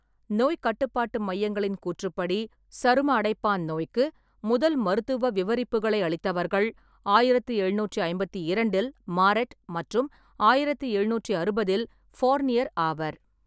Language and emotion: Tamil, neutral